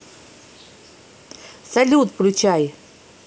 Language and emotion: Russian, positive